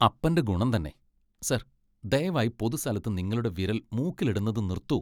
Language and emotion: Malayalam, disgusted